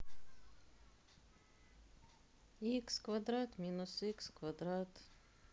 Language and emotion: Russian, sad